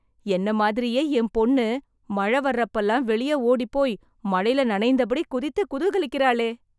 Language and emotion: Tamil, surprised